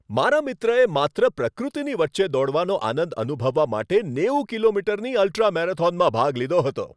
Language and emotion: Gujarati, happy